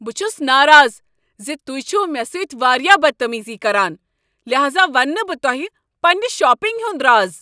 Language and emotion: Kashmiri, angry